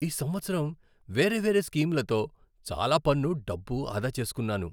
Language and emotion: Telugu, happy